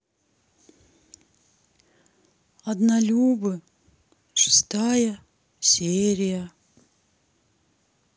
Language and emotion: Russian, sad